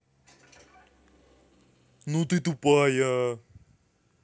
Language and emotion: Russian, angry